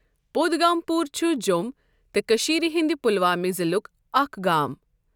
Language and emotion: Kashmiri, neutral